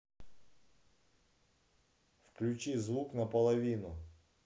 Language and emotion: Russian, neutral